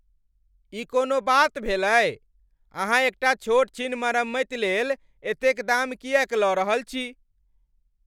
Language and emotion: Maithili, angry